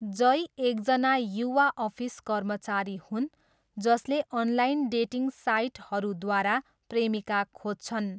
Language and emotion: Nepali, neutral